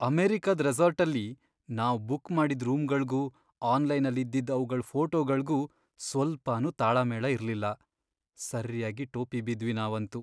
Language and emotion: Kannada, sad